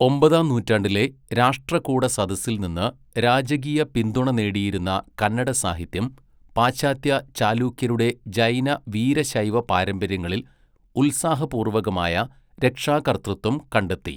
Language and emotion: Malayalam, neutral